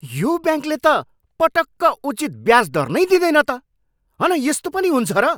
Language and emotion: Nepali, angry